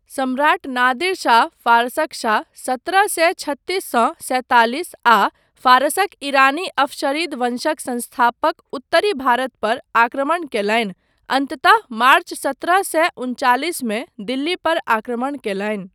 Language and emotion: Maithili, neutral